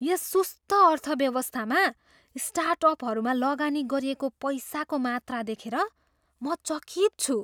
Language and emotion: Nepali, surprised